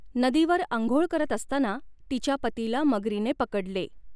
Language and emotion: Marathi, neutral